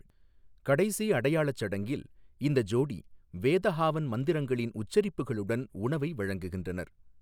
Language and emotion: Tamil, neutral